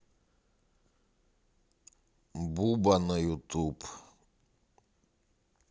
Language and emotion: Russian, neutral